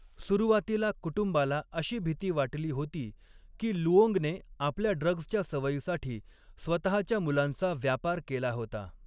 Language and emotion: Marathi, neutral